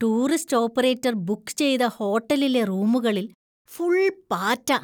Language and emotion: Malayalam, disgusted